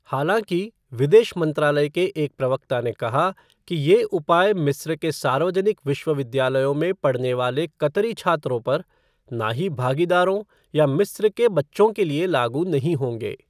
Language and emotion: Hindi, neutral